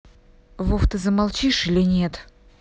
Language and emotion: Russian, angry